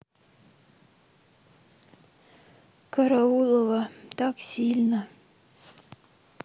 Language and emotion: Russian, sad